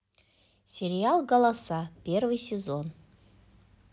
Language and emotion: Russian, positive